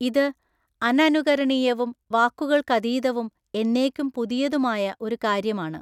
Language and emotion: Malayalam, neutral